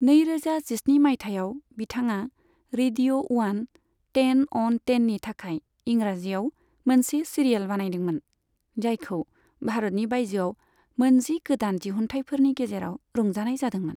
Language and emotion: Bodo, neutral